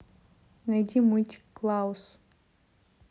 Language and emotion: Russian, neutral